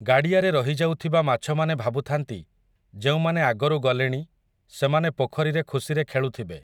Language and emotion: Odia, neutral